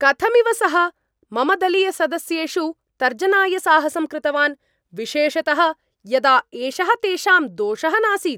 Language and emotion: Sanskrit, angry